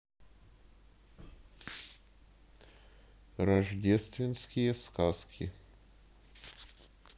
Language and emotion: Russian, neutral